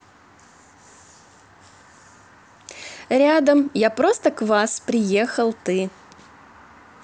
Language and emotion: Russian, positive